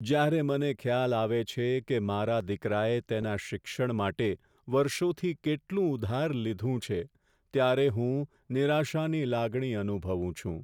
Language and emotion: Gujarati, sad